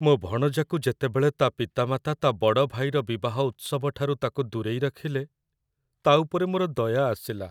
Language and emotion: Odia, sad